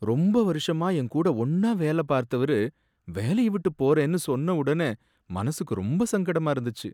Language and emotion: Tamil, sad